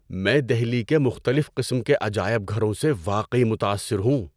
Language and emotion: Urdu, surprised